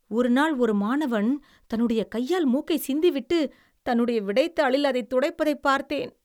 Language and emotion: Tamil, disgusted